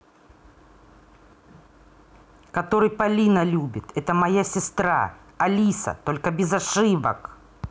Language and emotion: Russian, angry